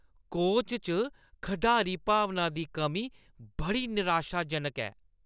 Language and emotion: Dogri, disgusted